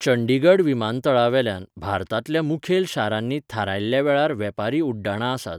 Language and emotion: Goan Konkani, neutral